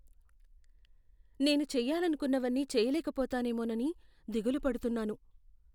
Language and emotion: Telugu, fearful